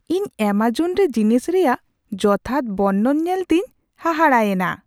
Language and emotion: Santali, surprised